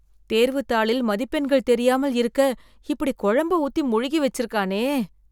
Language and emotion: Tamil, disgusted